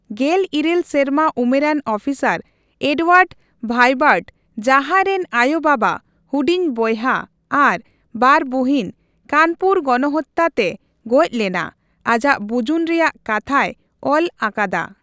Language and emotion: Santali, neutral